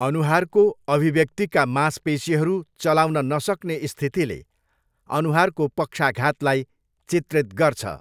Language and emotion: Nepali, neutral